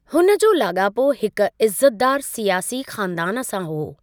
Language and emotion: Sindhi, neutral